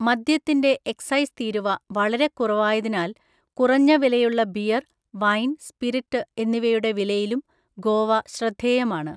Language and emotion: Malayalam, neutral